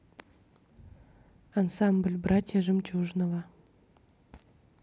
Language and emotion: Russian, neutral